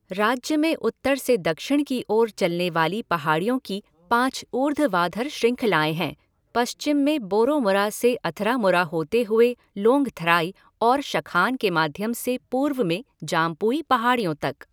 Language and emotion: Hindi, neutral